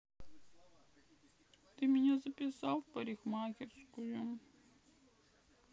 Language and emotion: Russian, sad